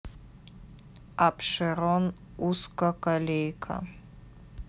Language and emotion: Russian, neutral